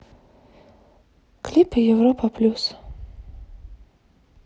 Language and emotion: Russian, sad